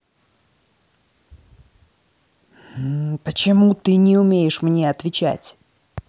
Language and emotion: Russian, angry